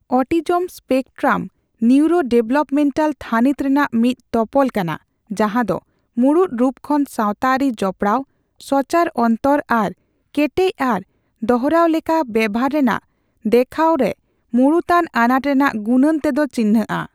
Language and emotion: Santali, neutral